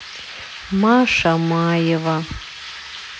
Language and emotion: Russian, sad